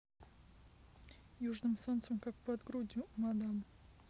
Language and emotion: Russian, neutral